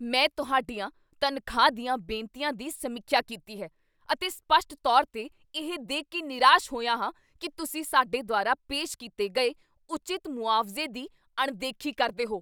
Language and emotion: Punjabi, angry